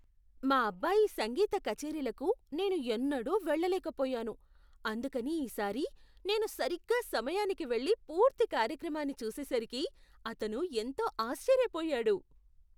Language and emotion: Telugu, surprised